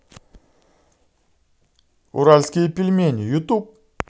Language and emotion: Russian, positive